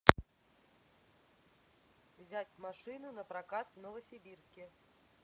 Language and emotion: Russian, neutral